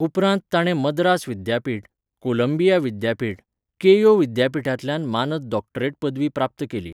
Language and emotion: Goan Konkani, neutral